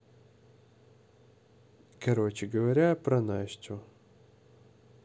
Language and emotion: Russian, neutral